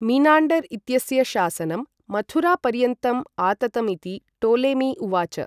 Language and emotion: Sanskrit, neutral